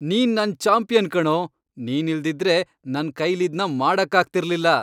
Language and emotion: Kannada, happy